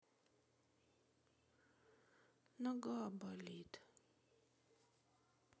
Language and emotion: Russian, sad